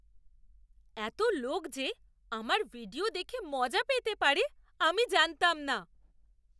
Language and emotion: Bengali, surprised